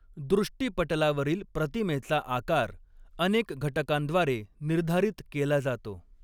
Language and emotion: Marathi, neutral